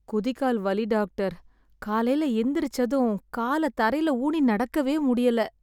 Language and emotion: Tamil, sad